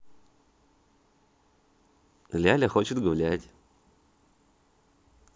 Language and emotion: Russian, positive